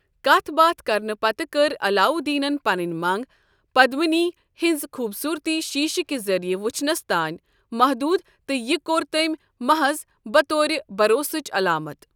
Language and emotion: Kashmiri, neutral